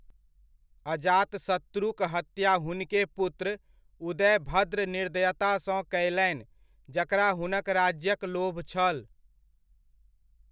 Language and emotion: Maithili, neutral